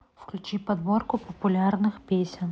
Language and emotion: Russian, neutral